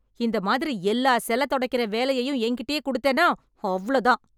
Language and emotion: Tamil, angry